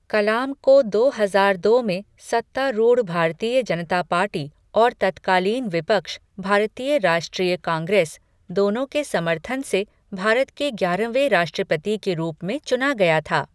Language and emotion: Hindi, neutral